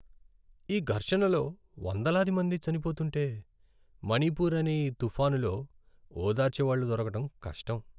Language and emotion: Telugu, sad